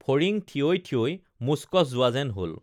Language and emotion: Assamese, neutral